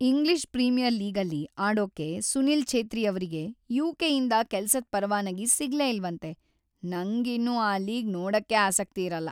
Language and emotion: Kannada, sad